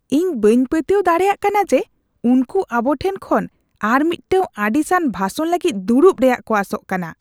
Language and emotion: Santali, disgusted